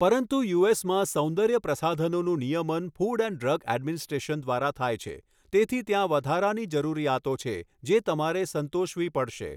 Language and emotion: Gujarati, neutral